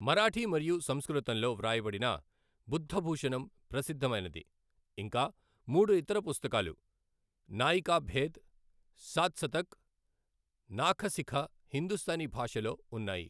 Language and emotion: Telugu, neutral